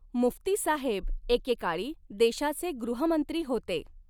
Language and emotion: Marathi, neutral